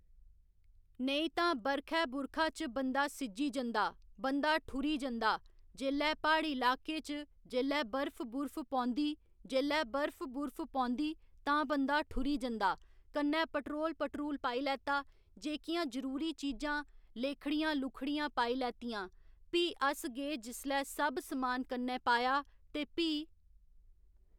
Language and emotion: Dogri, neutral